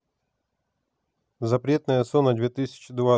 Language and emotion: Russian, neutral